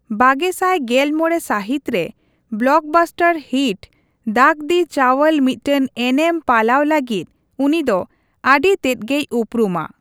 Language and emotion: Santali, neutral